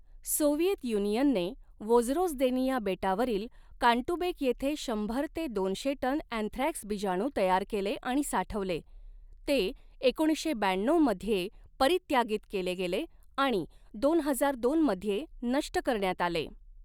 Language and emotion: Marathi, neutral